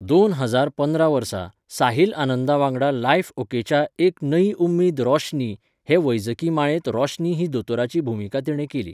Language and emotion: Goan Konkani, neutral